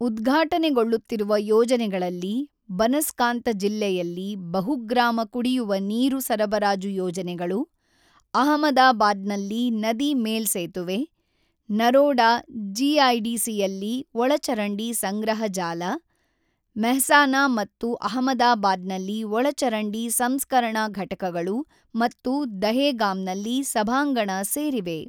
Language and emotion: Kannada, neutral